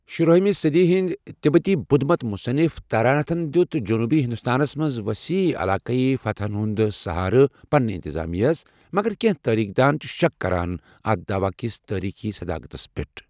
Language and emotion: Kashmiri, neutral